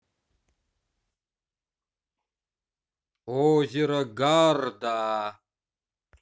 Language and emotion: Russian, positive